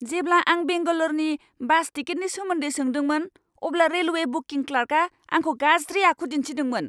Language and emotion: Bodo, angry